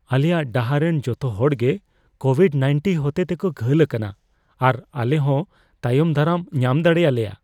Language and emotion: Santali, fearful